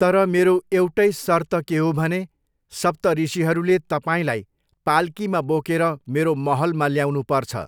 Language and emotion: Nepali, neutral